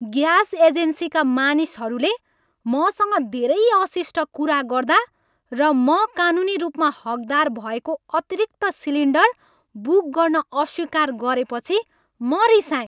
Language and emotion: Nepali, angry